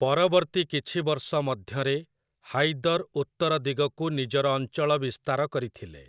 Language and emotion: Odia, neutral